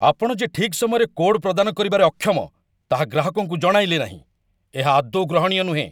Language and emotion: Odia, angry